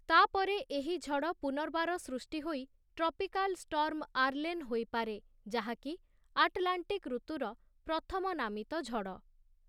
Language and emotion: Odia, neutral